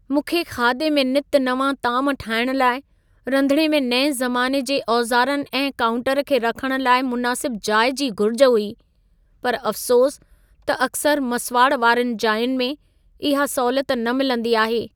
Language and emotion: Sindhi, sad